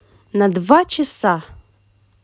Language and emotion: Russian, positive